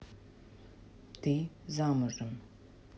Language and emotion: Russian, neutral